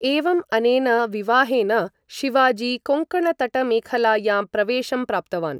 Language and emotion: Sanskrit, neutral